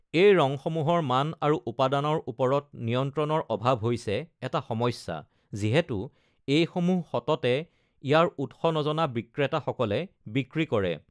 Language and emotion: Assamese, neutral